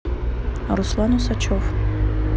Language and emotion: Russian, neutral